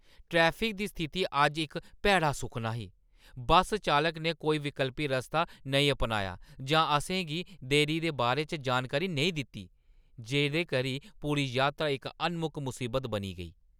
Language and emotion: Dogri, angry